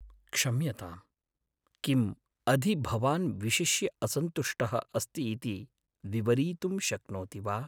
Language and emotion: Sanskrit, sad